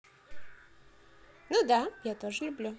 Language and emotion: Russian, positive